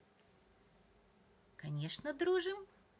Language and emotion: Russian, positive